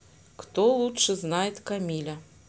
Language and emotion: Russian, neutral